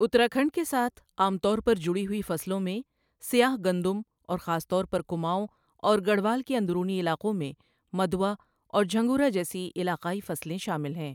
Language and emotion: Urdu, neutral